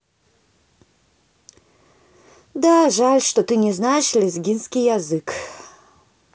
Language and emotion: Russian, sad